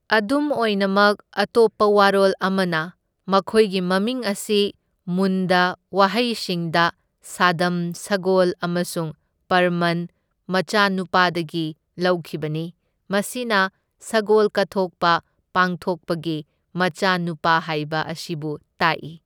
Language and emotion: Manipuri, neutral